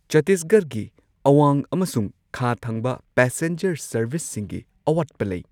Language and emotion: Manipuri, neutral